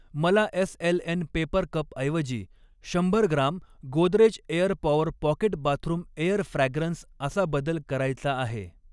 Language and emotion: Marathi, neutral